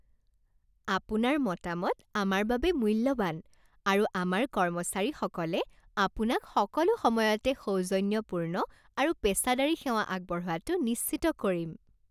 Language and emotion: Assamese, happy